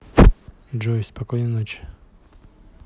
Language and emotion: Russian, neutral